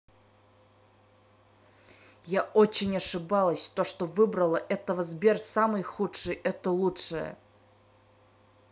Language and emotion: Russian, angry